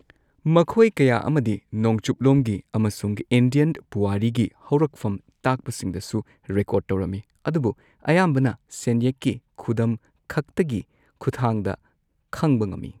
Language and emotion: Manipuri, neutral